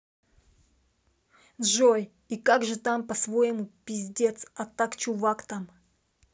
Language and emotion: Russian, angry